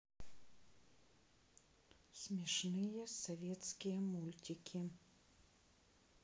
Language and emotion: Russian, neutral